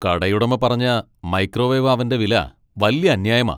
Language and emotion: Malayalam, angry